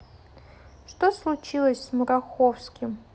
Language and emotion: Russian, neutral